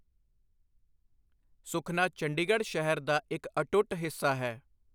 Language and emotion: Punjabi, neutral